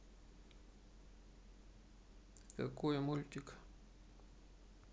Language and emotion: Russian, neutral